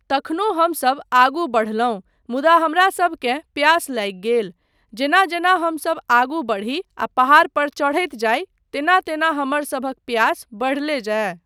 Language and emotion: Maithili, neutral